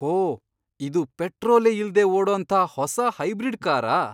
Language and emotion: Kannada, surprised